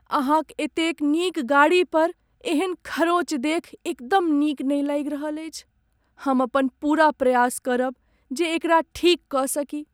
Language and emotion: Maithili, sad